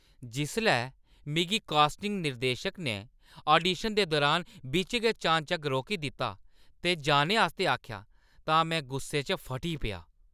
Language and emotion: Dogri, angry